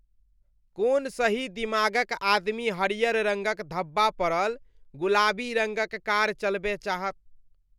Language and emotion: Maithili, disgusted